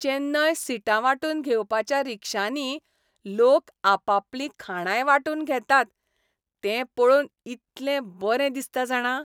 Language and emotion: Goan Konkani, happy